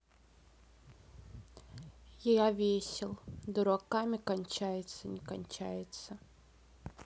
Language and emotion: Russian, sad